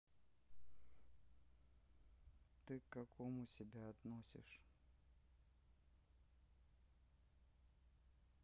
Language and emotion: Russian, neutral